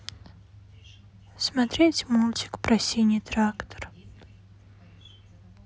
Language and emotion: Russian, sad